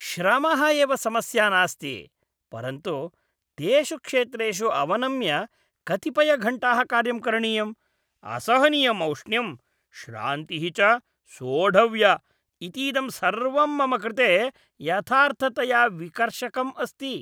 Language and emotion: Sanskrit, disgusted